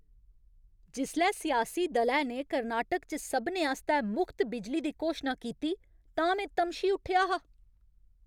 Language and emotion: Dogri, angry